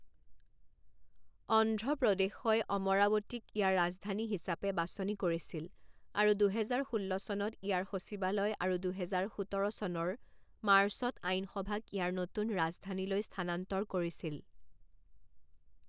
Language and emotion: Assamese, neutral